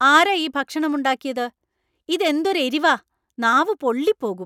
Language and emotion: Malayalam, angry